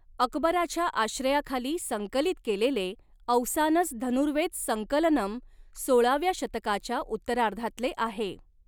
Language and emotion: Marathi, neutral